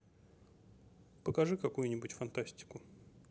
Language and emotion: Russian, neutral